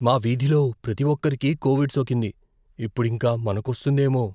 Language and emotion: Telugu, fearful